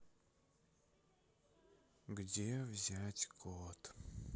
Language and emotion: Russian, sad